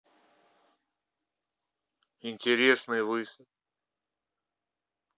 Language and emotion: Russian, neutral